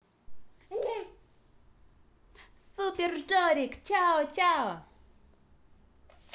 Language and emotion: Russian, positive